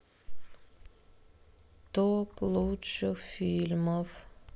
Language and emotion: Russian, sad